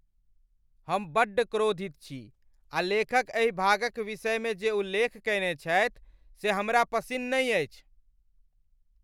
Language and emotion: Maithili, angry